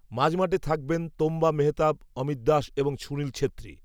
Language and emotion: Bengali, neutral